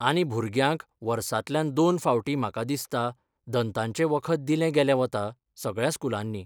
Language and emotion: Goan Konkani, neutral